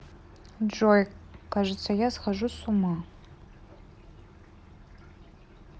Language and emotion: Russian, sad